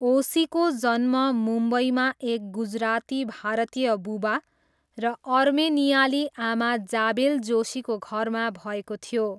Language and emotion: Nepali, neutral